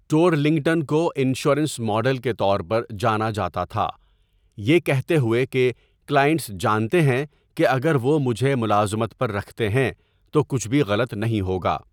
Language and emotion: Urdu, neutral